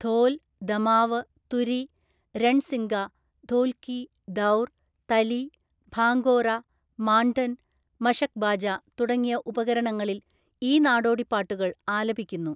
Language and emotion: Malayalam, neutral